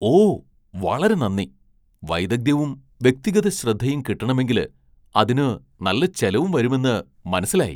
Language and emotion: Malayalam, surprised